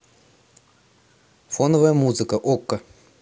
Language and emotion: Russian, neutral